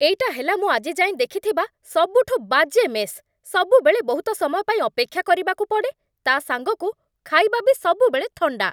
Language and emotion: Odia, angry